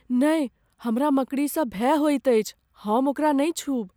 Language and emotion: Maithili, fearful